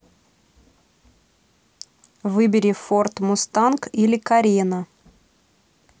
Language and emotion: Russian, neutral